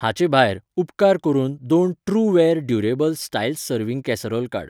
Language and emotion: Goan Konkani, neutral